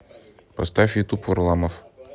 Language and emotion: Russian, neutral